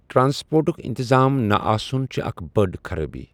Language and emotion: Kashmiri, neutral